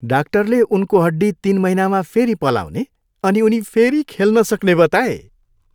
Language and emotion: Nepali, happy